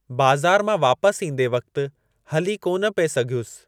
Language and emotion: Sindhi, neutral